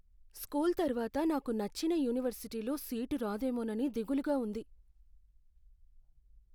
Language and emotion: Telugu, fearful